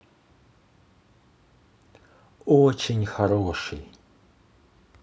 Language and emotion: Russian, positive